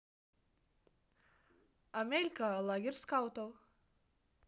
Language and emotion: Russian, neutral